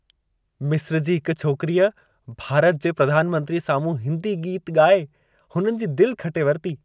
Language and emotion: Sindhi, happy